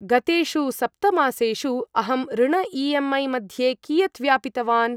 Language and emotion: Sanskrit, neutral